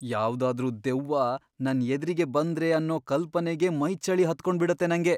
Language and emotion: Kannada, fearful